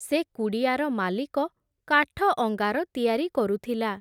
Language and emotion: Odia, neutral